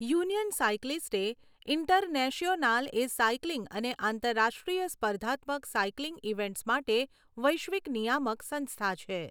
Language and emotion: Gujarati, neutral